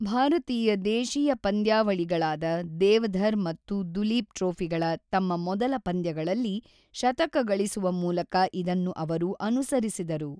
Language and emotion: Kannada, neutral